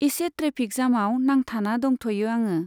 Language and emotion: Bodo, neutral